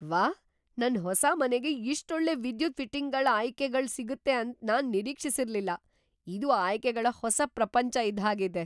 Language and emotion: Kannada, surprised